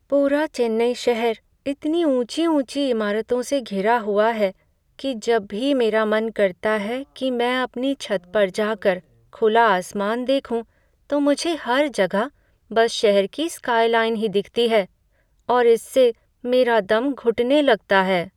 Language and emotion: Hindi, sad